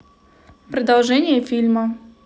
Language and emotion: Russian, neutral